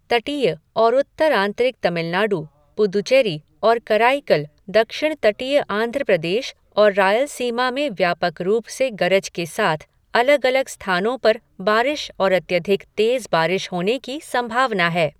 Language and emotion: Hindi, neutral